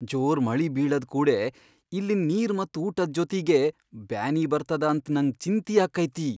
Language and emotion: Kannada, fearful